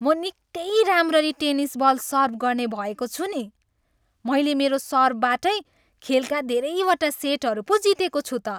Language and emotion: Nepali, happy